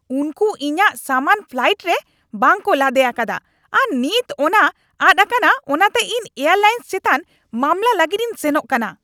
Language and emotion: Santali, angry